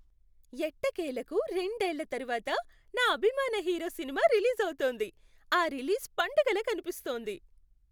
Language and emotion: Telugu, happy